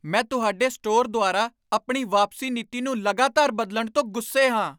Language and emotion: Punjabi, angry